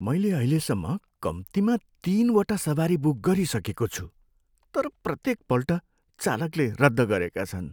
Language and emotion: Nepali, sad